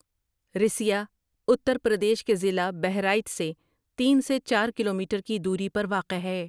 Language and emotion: Urdu, neutral